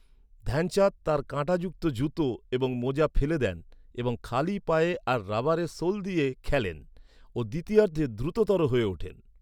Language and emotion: Bengali, neutral